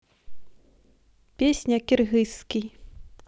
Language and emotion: Russian, neutral